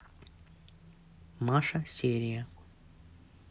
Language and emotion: Russian, neutral